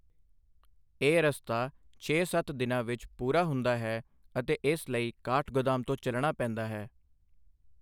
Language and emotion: Punjabi, neutral